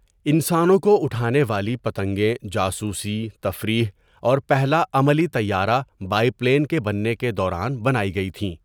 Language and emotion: Urdu, neutral